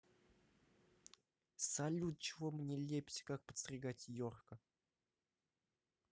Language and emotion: Russian, neutral